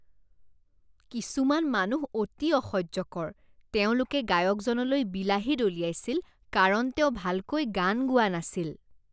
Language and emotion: Assamese, disgusted